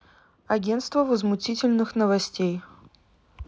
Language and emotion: Russian, neutral